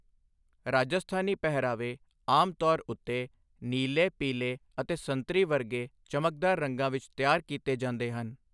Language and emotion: Punjabi, neutral